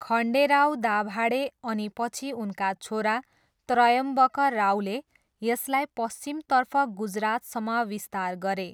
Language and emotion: Nepali, neutral